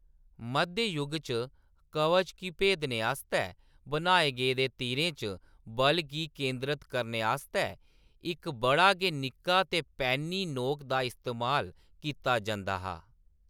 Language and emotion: Dogri, neutral